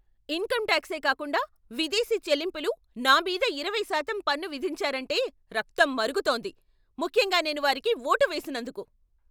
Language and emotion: Telugu, angry